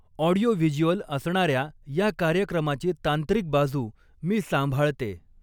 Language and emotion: Marathi, neutral